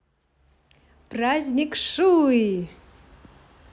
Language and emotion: Russian, positive